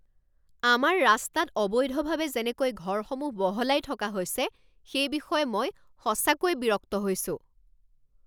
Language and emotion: Assamese, angry